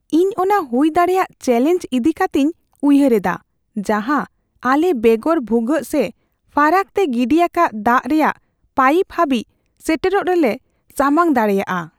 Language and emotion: Santali, fearful